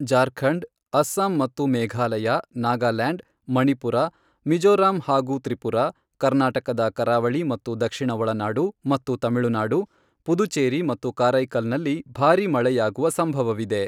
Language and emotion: Kannada, neutral